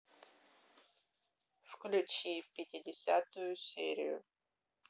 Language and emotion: Russian, neutral